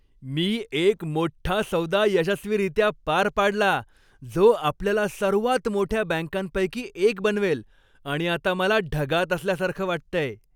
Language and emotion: Marathi, happy